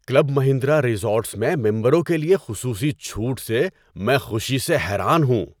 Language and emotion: Urdu, surprised